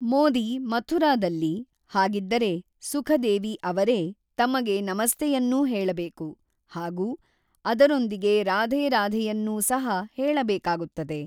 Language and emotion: Kannada, neutral